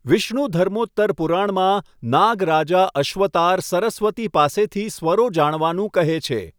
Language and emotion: Gujarati, neutral